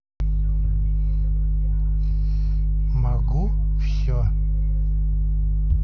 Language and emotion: Russian, neutral